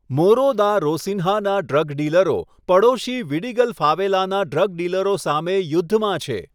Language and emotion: Gujarati, neutral